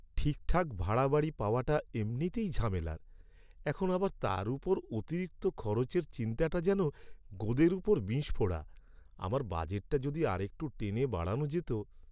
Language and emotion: Bengali, sad